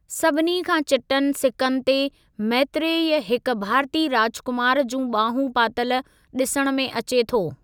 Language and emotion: Sindhi, neutral